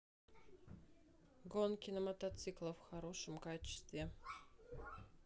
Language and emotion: Russian, neutral